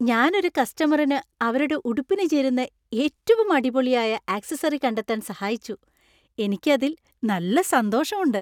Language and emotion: Malayalam, happy